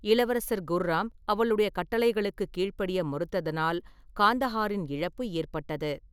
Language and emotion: Tamil, neutral